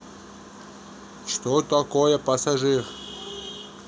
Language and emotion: Russian, neutral